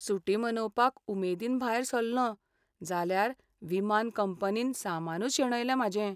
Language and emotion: Goan Konkani, sad